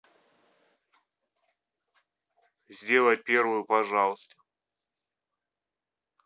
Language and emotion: Russian, neutral